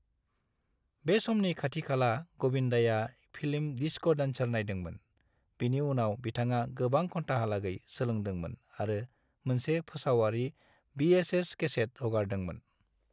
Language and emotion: Bodo, neutral